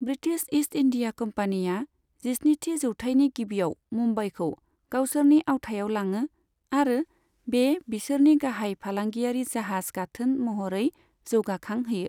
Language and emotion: Bodo, neutral